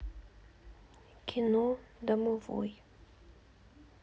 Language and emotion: Russian, sad